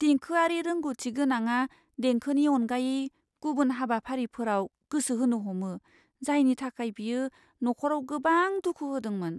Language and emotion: Bodo, fearful